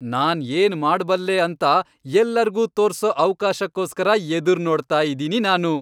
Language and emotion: Kannada, happy